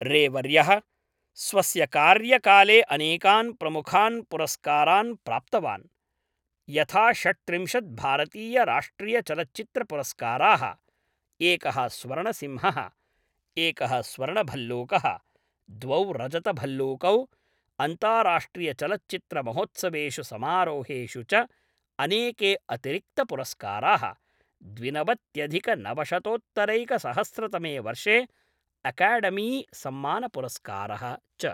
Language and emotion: Sanskrit, neutral